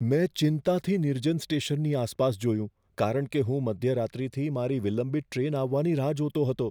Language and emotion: Gujarati, fearful